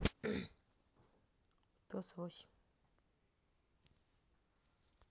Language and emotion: Russian, neutral